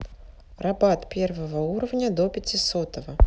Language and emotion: Russian, neutral